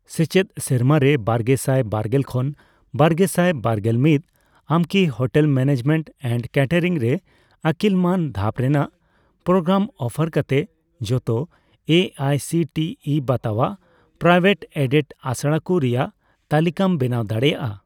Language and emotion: Santali, neutral